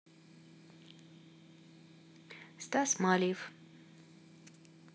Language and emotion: Russian, neutral